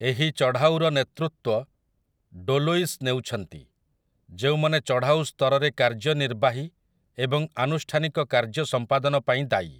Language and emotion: Odia, neutral